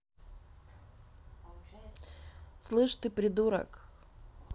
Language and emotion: Russian, neutral